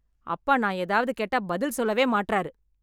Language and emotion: Tamil, angry